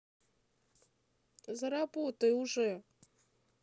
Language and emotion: Russian, sad